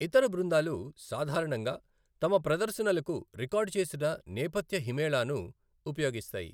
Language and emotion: Telugu, neutral